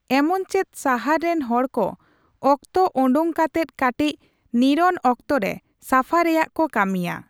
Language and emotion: Santali, neutral